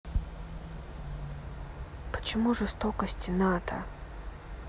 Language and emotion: Russian, sad